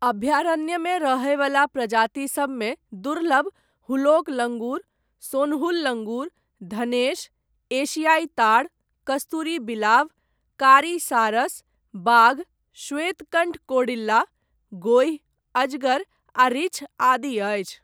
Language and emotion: Maithili, neutral